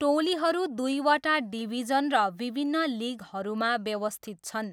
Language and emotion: Nepali, neutral